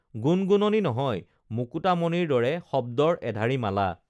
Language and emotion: Assamese, neutral